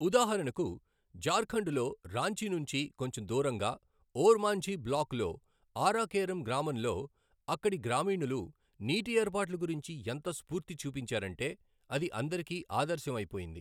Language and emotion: Telugu, neutral